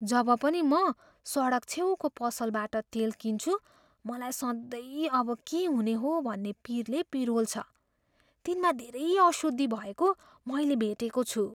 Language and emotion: Nepali, fearful